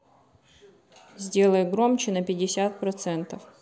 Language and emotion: Russian, neutral